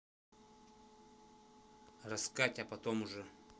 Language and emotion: Russian, angry